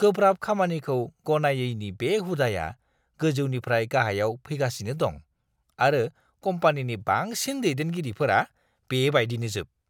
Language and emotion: Bodo, disgusted